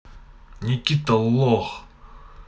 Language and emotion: Russian, angry